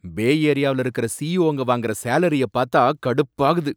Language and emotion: Tamil, angry